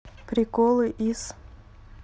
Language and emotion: Russian, neutral